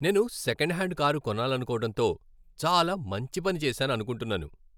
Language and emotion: Telugu, happy